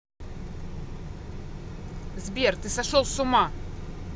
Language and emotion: Russian, angry